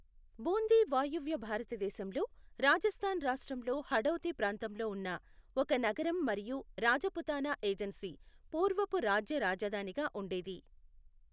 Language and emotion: Telugu, neutral